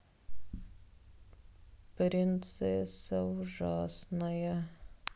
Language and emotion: Russian, sad